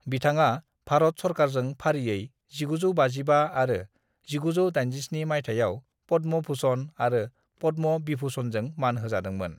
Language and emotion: Bodo, neutral